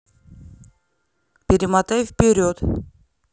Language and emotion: Russian, neutral